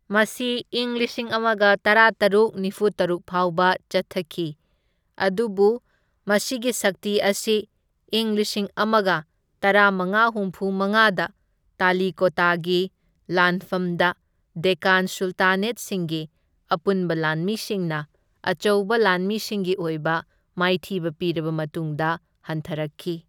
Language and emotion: Manipuri, neutral